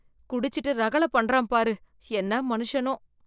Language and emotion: Tamil, disgusted